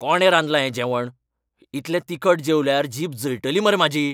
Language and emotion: Goan Konkani, angry